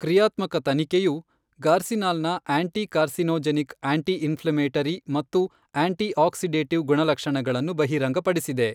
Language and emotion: Kannada, neutral